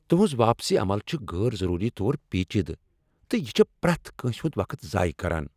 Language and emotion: Kashmiri, angry